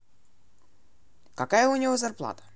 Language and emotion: Russian, neutral